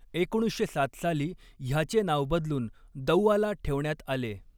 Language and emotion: Marathi, neutral